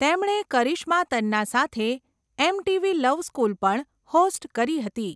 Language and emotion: Gujarati, neutral